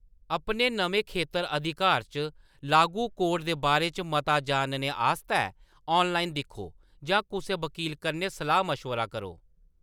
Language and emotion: Dogri, neutral